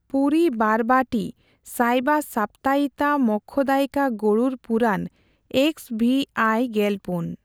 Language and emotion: Santali, neutral